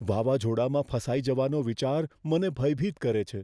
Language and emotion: Gujarati, fearful